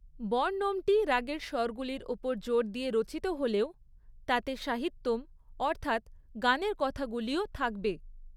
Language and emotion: Bengali, neutral